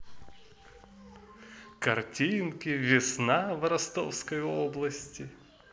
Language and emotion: Russian, positive